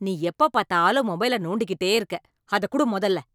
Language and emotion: Tamil, angry